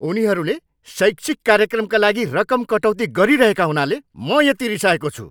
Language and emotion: Nepali, angry